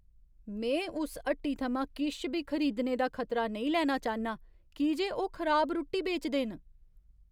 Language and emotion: Dogri, fearful